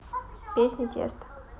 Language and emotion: Russian, neutral